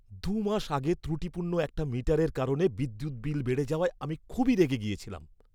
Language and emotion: Bengali, angry